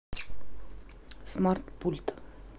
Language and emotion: Russian, neutral